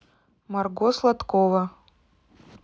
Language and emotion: Russian, neutral